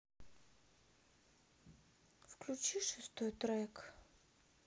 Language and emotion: Russian, sad